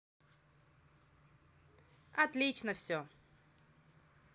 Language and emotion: Russian, positive